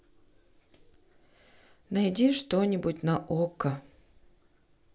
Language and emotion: Russian, sad